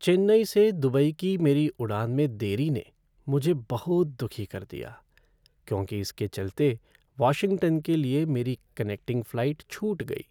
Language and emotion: Hindi, sad